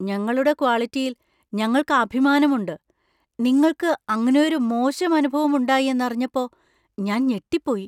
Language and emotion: Malayalam, surprised